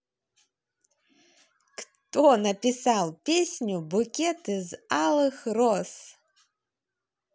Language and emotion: Russian, positive